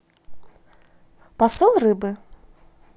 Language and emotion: Russian, positive